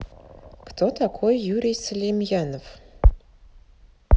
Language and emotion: Russian, neutral